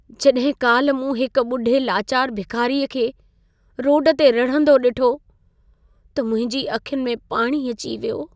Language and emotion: Sindhi, sad